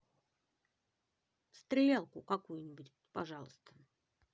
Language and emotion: Russian, neutral